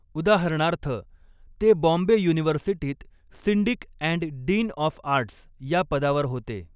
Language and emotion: Marathi, neutral